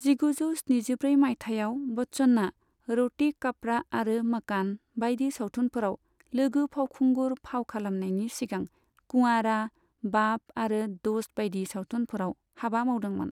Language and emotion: Bodo, neutral